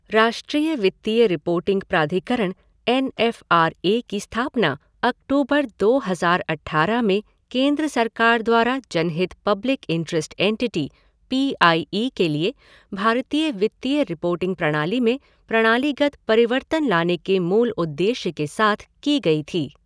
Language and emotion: Hindi, neutral